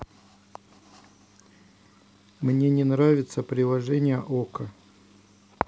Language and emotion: Russian, neutral